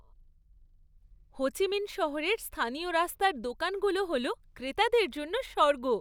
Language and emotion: Bengali, happy